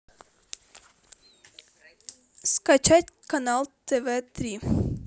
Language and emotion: Russian, neutral